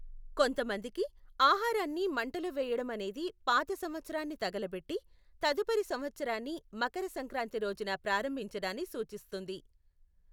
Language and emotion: Telugu, neutral